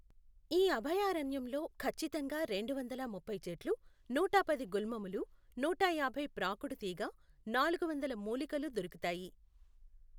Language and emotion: Telugu, neutral